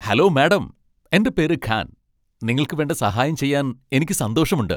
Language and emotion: Malayalam, happy